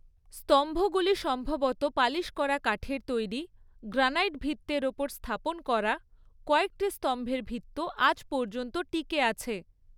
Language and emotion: Bengali, neutral